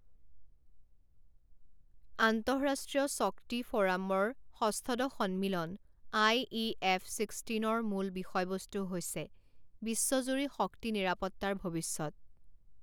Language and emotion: Assamese, neutral